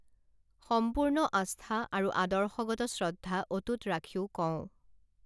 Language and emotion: Assamese, neutral